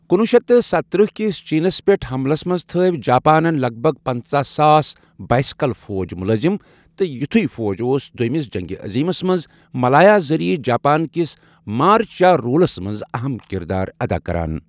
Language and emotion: Kashmiri, neutral